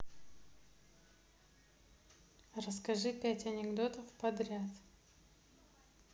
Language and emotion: Russian, neutral